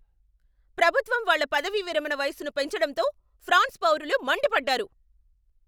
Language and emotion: Telugu, angry